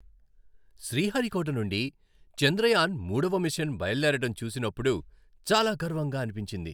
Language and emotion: Telugu, happy